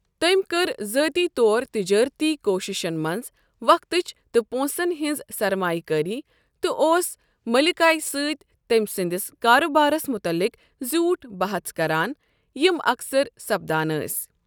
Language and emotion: Kashmiri, neutral